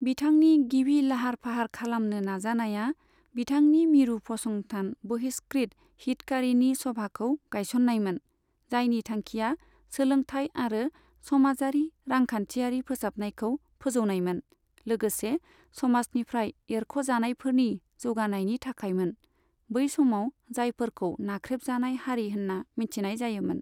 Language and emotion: Bodo, neutral